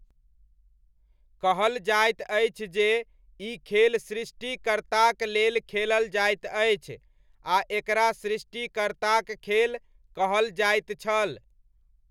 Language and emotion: Maithili, neutral